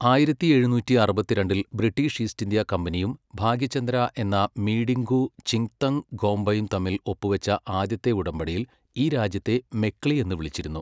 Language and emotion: Malayalam, neutral